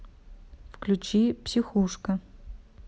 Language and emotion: Russian, neutral